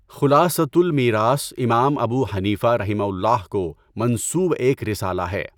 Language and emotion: Urdu, neutral